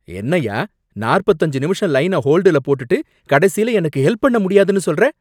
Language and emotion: Tamil, angry